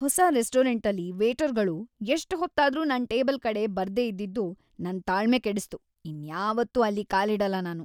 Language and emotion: Kannada, disgusted